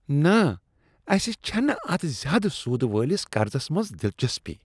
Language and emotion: Kashmiri, disgusted